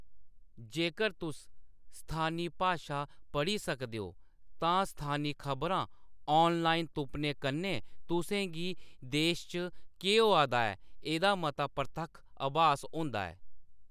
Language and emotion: Dogri, neutral